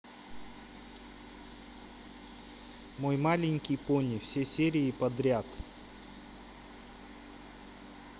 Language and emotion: Russian, neutral